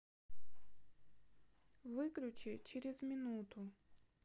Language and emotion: Russian, neutral